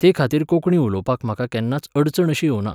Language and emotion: Goan Konkani, neutral